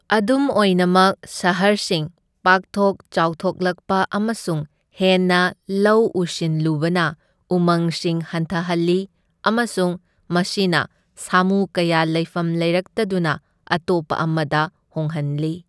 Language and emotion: Manipuri, neutral